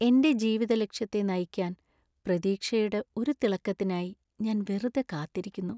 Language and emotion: Malayalam, sad